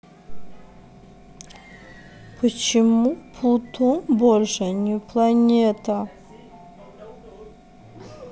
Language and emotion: Russian, neutral